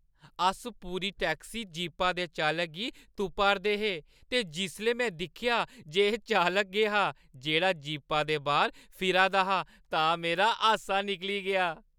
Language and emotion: Dogri, happy